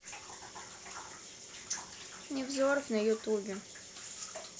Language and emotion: Russian, neutral